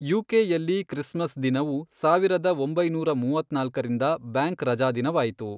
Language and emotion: Kannada, neutral